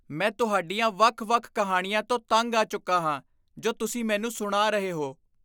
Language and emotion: Punjabi, disgusted